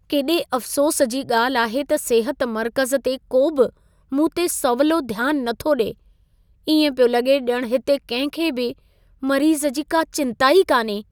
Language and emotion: Sindhi, sad